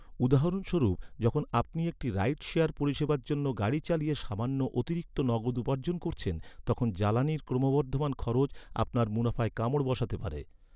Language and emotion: Bengali, neutral